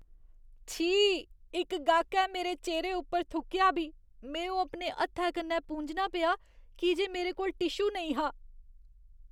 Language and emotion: Dogri, disgusted